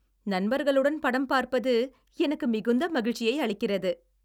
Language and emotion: Tamil, happy